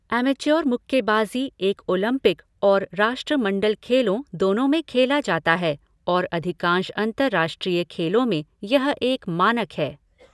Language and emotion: Hindi, neutral